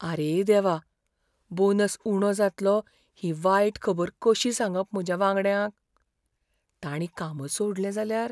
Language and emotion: Goan Konkani, fearful